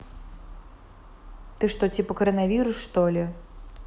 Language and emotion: Russian, neutral